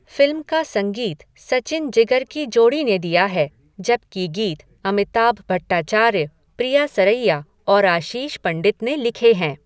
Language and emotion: Hindi, neutral